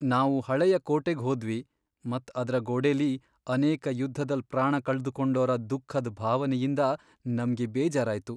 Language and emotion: Kannada, sad